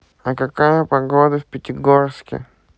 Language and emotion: Russian, neutral